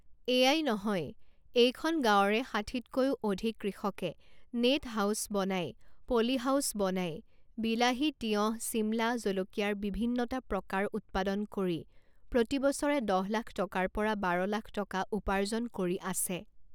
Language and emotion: Assamese, neutral